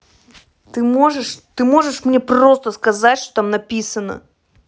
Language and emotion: Russian, angry